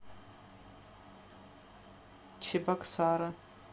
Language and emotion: Russian, neutral